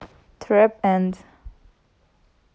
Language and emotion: Russian, neutral